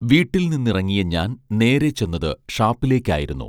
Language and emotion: Malayalam, neutral